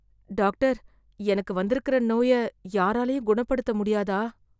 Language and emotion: Tamil, fearful